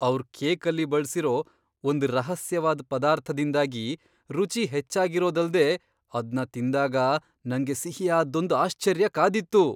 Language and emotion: Kannada, surprised